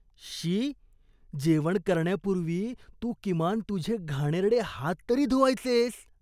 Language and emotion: Marathi, disgusted